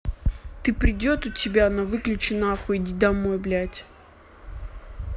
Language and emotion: Russian, angry